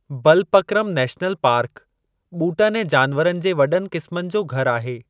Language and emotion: Sindhi, neutral